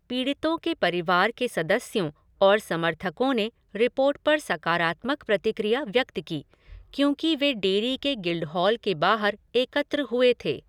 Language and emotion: Hindi, neutral